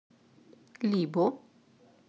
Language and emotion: Russian, neutral